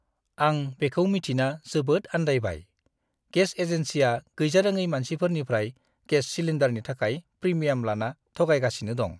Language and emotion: Bodo, disgusted